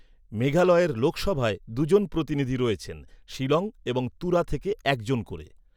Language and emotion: Bengali, neutral